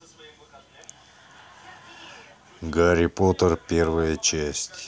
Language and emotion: Russian, neutral